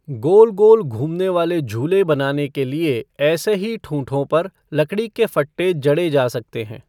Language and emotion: Hindi, neutral